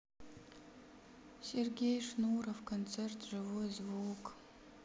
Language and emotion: Russian, sad